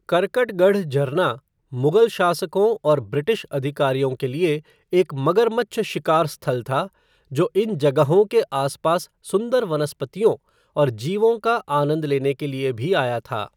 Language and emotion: Hindi, neutral